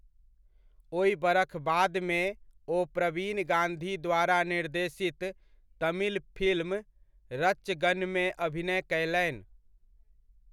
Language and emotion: Maithili, neutral